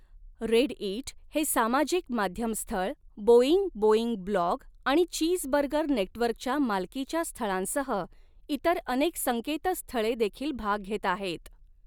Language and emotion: Marathi, neutral